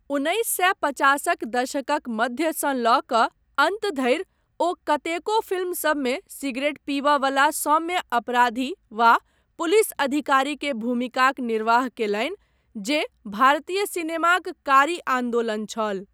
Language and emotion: Maithili, neutral